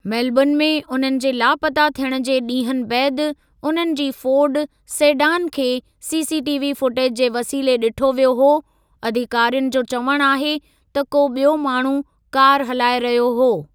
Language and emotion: Sindhi, neutral